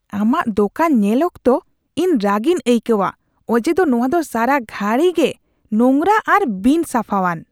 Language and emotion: Santali, disgusted